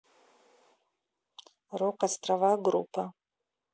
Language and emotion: Russian, neutral